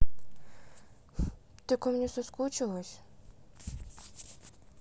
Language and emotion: Russian, sad